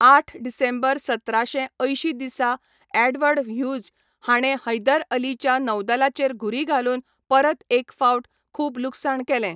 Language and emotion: Goan Konkani, neutral